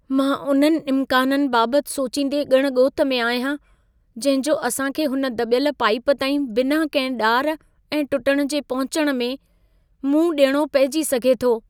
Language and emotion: Sindhi, fearful